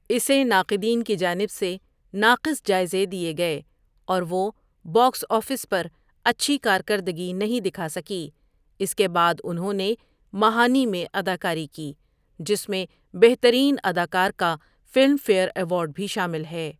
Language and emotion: Urdu, neutral